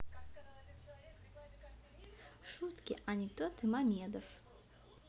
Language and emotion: Russian, neutral